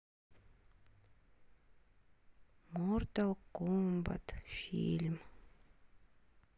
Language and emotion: Russian, sad